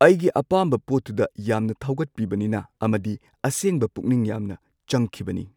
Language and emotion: Manipuri, neutral